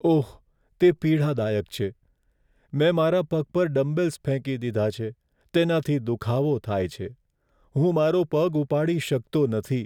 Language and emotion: Gujarati, sad